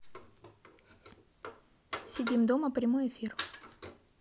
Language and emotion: Russian, neutral